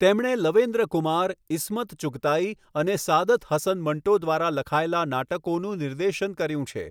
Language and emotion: Gujarati, neutral